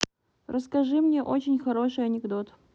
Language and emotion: Russian, neutral